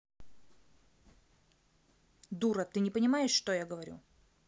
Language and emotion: Russian, angry